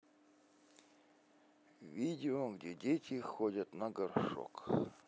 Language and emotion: Russian, neutral